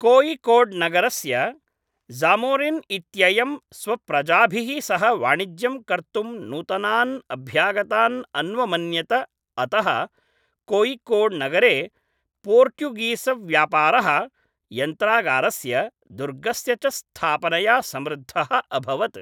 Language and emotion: Sanskrit, neutral